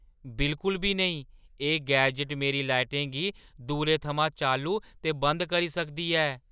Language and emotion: Dogri, surprised